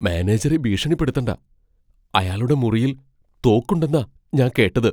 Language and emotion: Malayalam, fearful